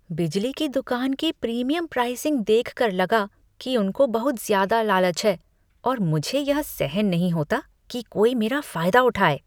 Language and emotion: Hindi, disgusted